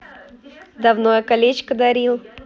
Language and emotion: Russian, positive